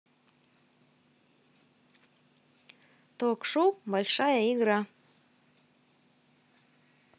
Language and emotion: Russian, positive